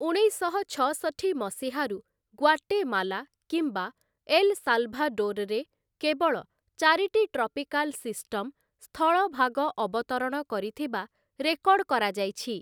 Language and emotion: Odia, neutral